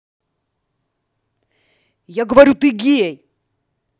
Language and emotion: Russian, angry